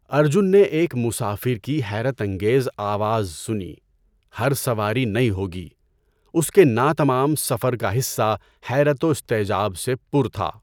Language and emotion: Urdu, neutral